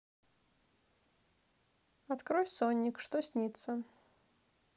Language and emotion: Russian, neutral